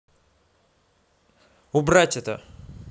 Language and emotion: Russian, angry